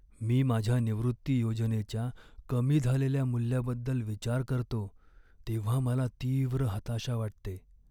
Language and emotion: Marathi, sad